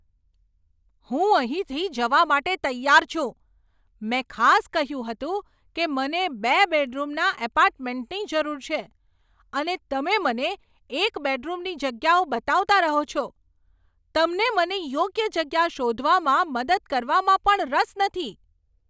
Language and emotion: Gujarati, angry